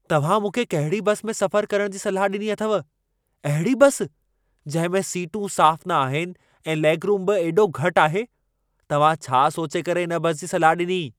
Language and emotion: Sindhi, angry